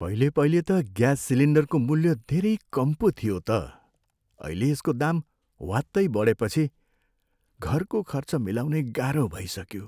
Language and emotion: Nepali, sad